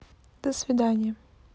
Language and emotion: Russian, neutral